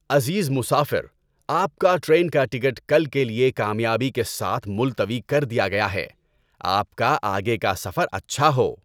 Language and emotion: Urdu, happy